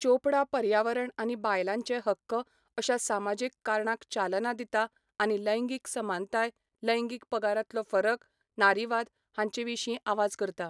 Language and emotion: Goan Konkani, neutral